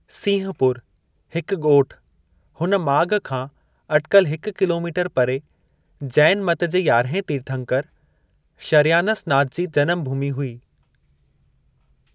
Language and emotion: Sindhi, neutral